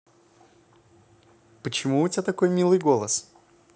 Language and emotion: Russian, positive